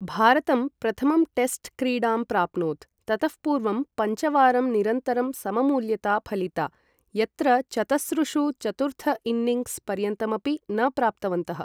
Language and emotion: Sanskrit, neutral